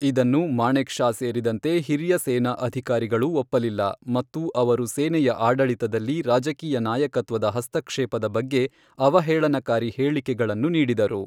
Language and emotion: Kannada, neutral